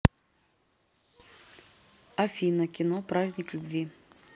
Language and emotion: Russian, neutral